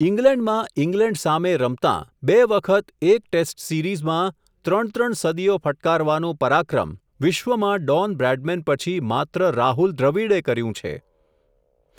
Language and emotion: Gujarati, neutral